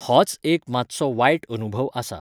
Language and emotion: Goan Konkani, neutral